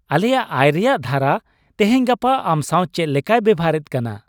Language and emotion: Santali, happy